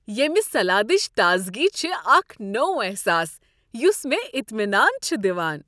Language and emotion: Kashmiri, happy